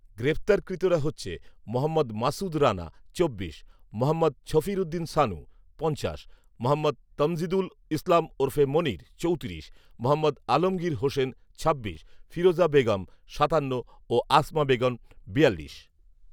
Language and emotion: Bengali, neutral